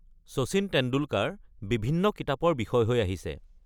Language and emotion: Assamese, neutral